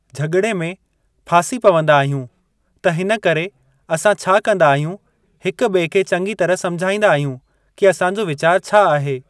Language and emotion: Sindhi, neutral